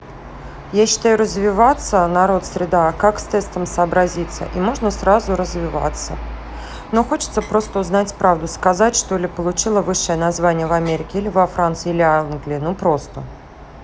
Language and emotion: Russian, neutral